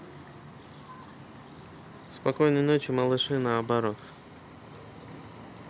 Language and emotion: Russian, neutral